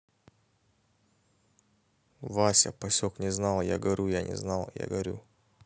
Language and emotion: Russian, neutral